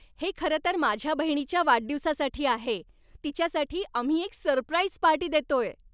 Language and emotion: Marathi, happy